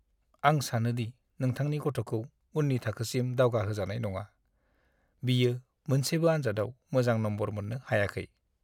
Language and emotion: Bodo, sad